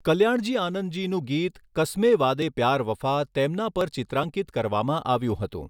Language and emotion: Gujarati, neutral